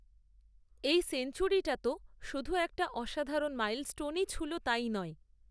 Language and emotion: Bengali, neutral